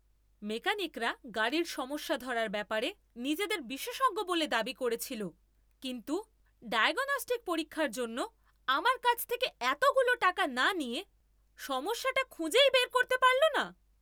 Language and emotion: Bengali, angry